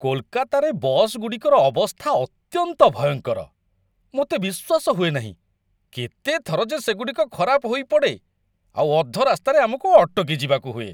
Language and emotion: Odia, disgusted